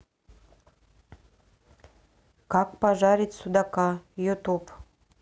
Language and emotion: Russian, neutral